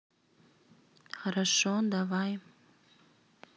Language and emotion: Russian, neutral